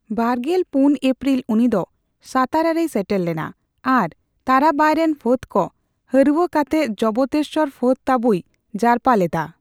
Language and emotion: Santali, neutral